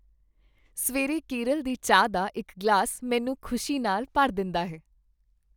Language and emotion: Punjabi, happy